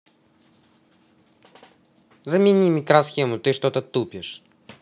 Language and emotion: Russian, angry